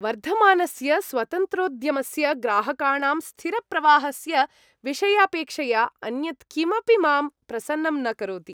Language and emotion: Sanskrit, happy